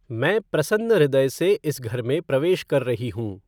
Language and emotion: Hindi, neutral